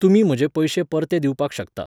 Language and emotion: Goan Konkani, neutral